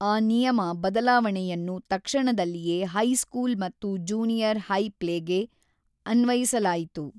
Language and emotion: Kannada, neutral